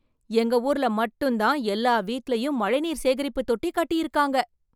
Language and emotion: Tamil, surprised